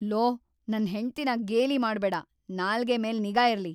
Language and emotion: Kannada, angry